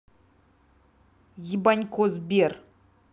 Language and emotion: Russian, angry